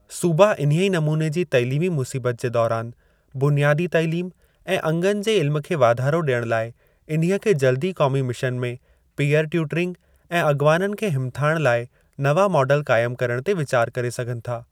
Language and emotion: Sindhi, neutral